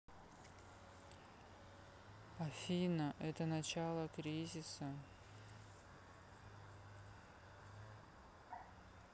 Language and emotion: Russian, sad